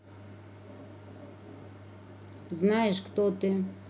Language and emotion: Russian, neutral